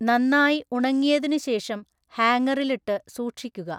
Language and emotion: Malayalam, neutral